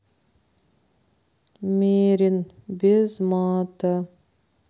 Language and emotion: Russian, sad